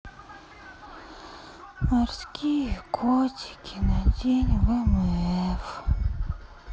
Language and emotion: Russian, sad